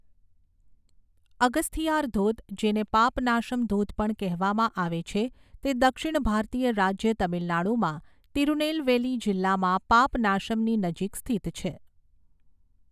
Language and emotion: Gujarati, neutral